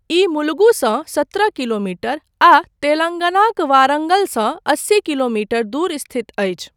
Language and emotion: Maithili, neutral